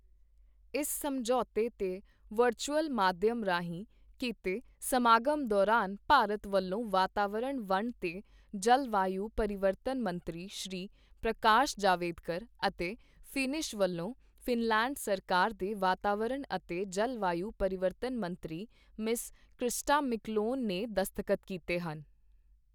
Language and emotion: Punjabi, neutral